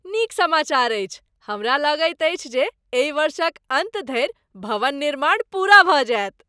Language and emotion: Maithili, happy